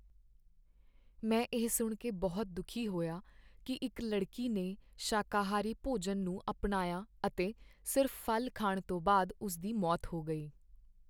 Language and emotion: Punjabi, sad